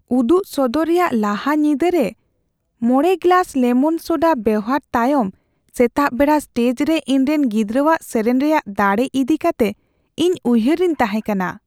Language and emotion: Santali, fearful